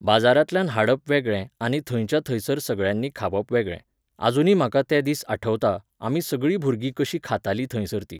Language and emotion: Goan Konkani, neutral